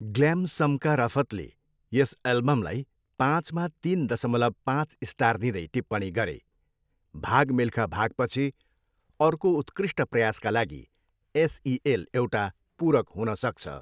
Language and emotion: Nepali, neutral